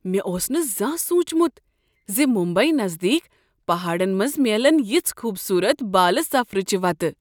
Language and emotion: Kashmiri, surprised